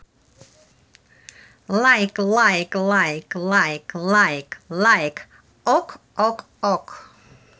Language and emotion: Russian, positive